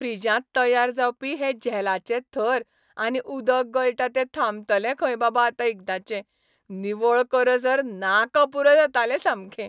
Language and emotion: Goan Konkani, happy